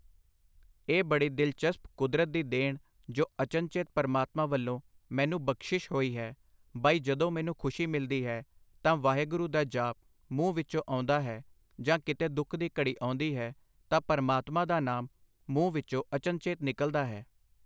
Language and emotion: Punjabi, neutral